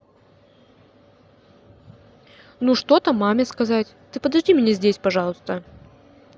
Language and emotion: Russian, neutral